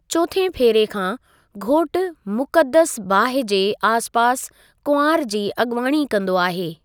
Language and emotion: Sindhi, neutral